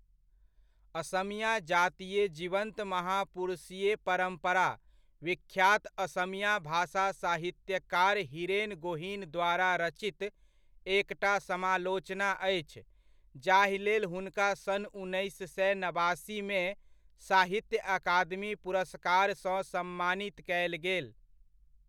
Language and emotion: Maithili, neutral